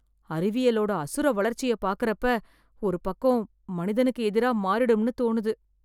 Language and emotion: Tamil, fearful